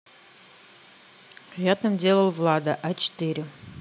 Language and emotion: Russian, neutral